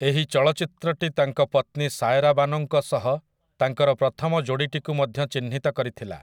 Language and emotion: Odia, neutral